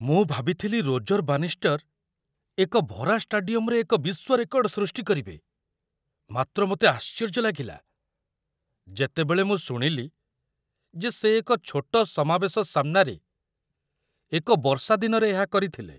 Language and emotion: Odia, surprised